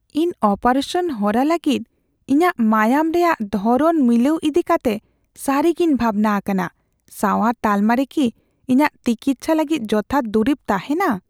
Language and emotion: Santali, fearful